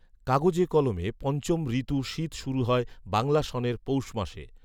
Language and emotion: Bengali, neutral